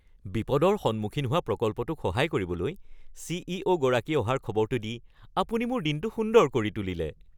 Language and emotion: Assamese, happy